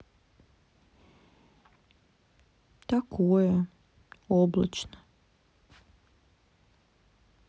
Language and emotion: Russian, sad